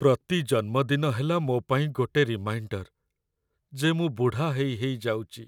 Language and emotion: Odia, sad